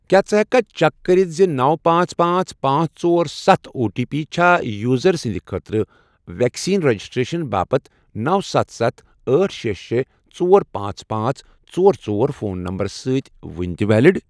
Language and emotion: Kashmiri, neutral